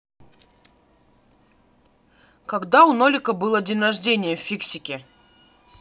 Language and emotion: Russian, neutral